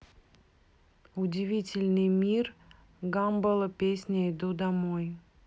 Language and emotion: Russian, neutral